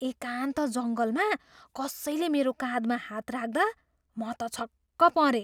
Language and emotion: Nepali, surprised